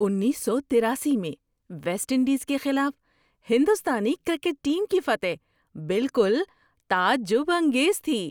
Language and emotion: Urdu, surprised